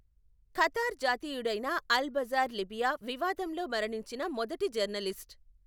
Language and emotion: Telugu, neutral